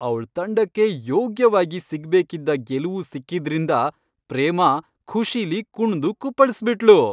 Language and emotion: Kannada, happy